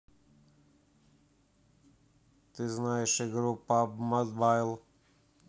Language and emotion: Russian, neutral